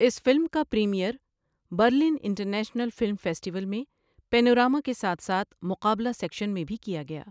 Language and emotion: Urdu, neutral